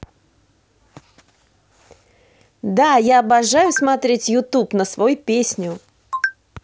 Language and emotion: Russian, positive